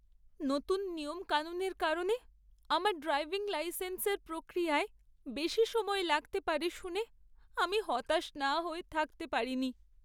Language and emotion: Bengali, sad